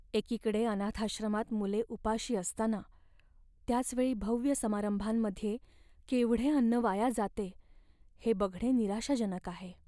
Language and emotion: Marathi, sad